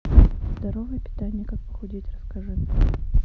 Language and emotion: Russian, neutral